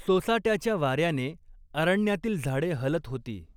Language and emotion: Marathi, neutral